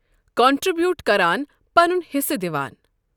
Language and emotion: Kashmiri, neutral